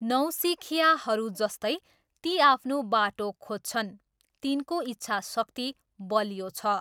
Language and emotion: Nepali, neutral